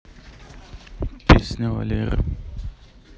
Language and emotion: Russian, neutral